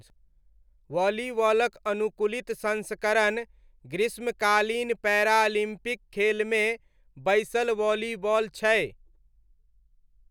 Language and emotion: Maithili, neutral